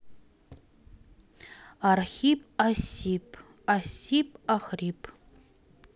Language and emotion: Russian, neutral